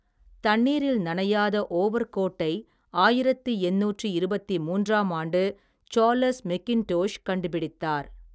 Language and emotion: Tamil, neutral